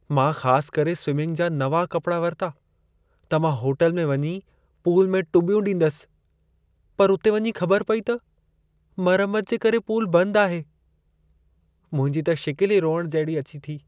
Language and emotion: Sindhi, sad